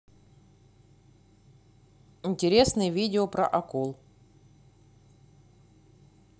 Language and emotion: Russian, neutral